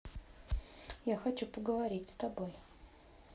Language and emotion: Russian, neutral